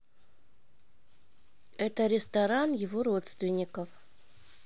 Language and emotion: Russian, neutral